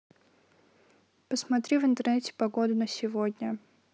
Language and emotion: Russian, neutral